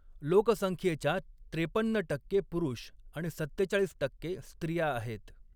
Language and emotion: Marathi, neutral